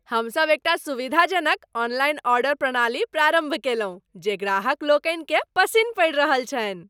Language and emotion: Maithili, happy